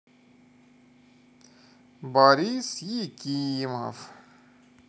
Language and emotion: Russian, positive